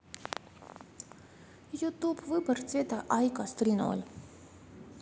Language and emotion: Russian, neutral